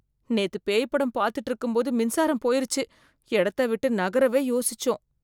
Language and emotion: Tamil, fearful